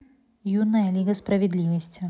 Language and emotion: Russian, neutral